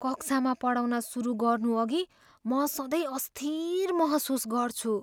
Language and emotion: Nepali, fearful